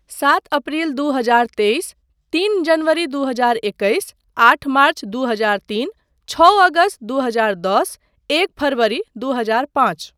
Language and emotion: Maithili, neutral